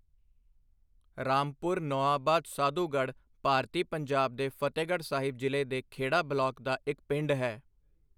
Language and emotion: Punjabi, neutral